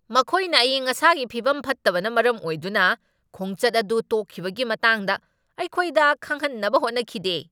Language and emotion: Manipuri, angry